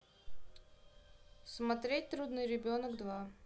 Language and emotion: Russian, neutral